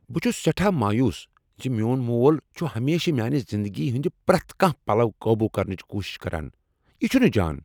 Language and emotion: Kashmiri, angry